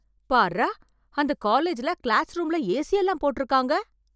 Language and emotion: Tamil, surprised